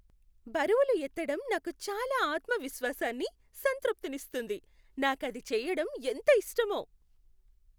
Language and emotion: Telugu, happy